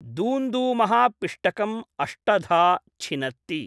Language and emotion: Sanskrit, neutral